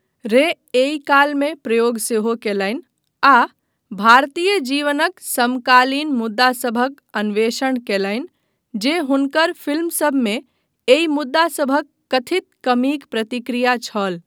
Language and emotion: Maithili, neutral